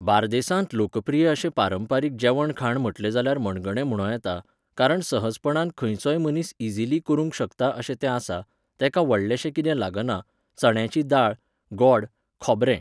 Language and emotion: Goan Konkani, neutral